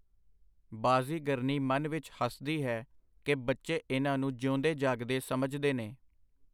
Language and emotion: Punjabi, neutral